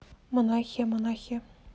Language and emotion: Russian, neutral